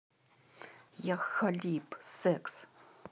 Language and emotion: Russian, angry